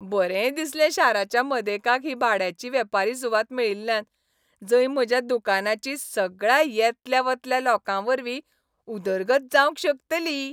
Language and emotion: Goan Konkani, happy